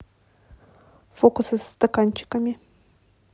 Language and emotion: Russian, neutral